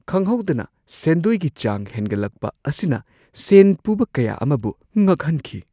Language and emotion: Manipuri, surprised